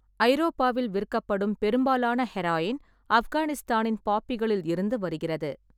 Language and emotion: Tamil, neutral